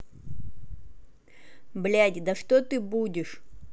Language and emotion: Russian, angry